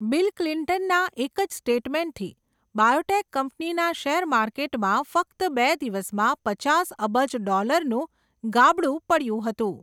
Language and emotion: Gujarati, neutral